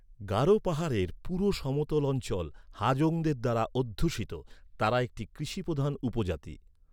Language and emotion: Bengali, neutral